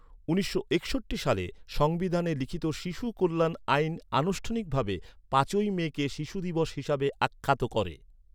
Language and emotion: Bengali, neutral